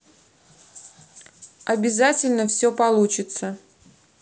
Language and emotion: Russian, neutral